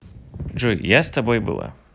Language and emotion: Russian, neutral